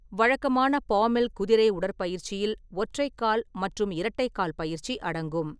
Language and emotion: Tamil, neutral